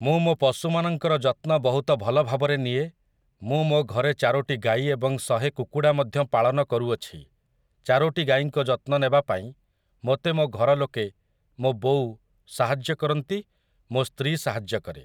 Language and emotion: Odia, neutral